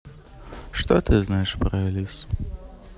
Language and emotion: Russian, sad